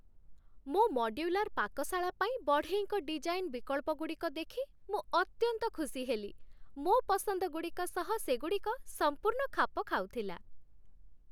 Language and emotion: Odia, happy